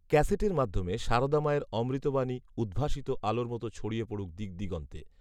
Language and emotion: Bengali, neutral